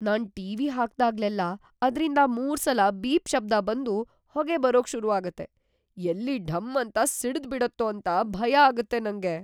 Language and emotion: Kannada, fearful